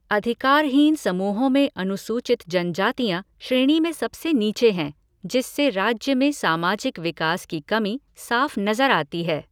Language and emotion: Hindi, neutral